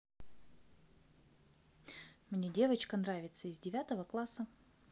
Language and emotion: Russian, neutral